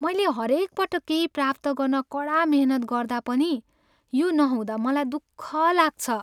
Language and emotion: Nepali, sad